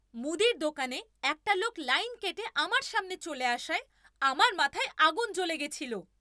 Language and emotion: Bengali, angry